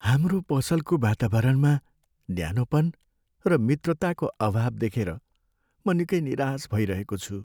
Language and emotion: Nepali, sad